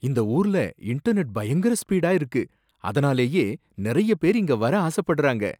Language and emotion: Tamil, surprised